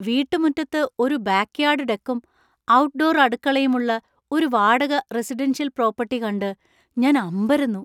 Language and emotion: Malayalam, surprised